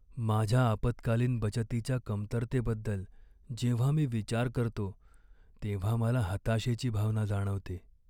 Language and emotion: Marathi, sad